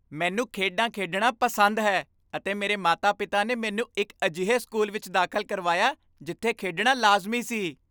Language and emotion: Punjabi, happy